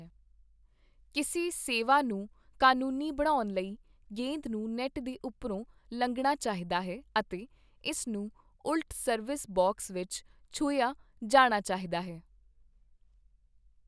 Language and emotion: Punjabi, neutral